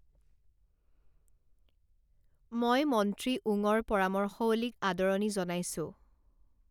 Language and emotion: Assamese, neutral